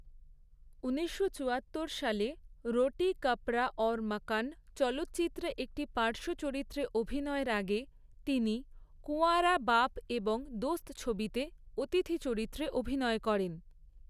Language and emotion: Bengali, neutral